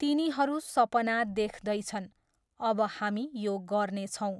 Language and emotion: Nepali, neutral